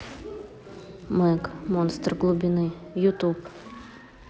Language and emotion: Russian, neutral